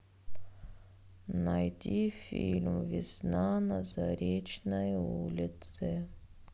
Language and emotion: Russian, sad